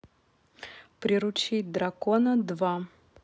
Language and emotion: Russian, neutral